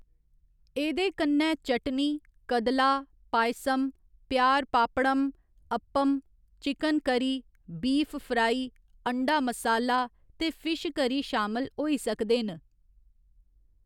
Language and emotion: Dogri, neutral